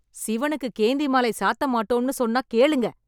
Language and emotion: Tamil, angry